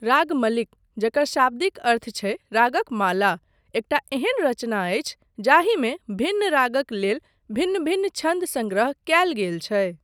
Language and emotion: Maithili, neutral